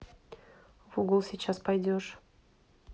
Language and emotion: Russian, neutral